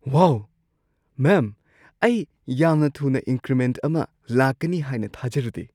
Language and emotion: Manipuri, surprised